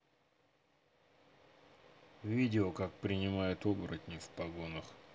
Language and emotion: Russian, neutral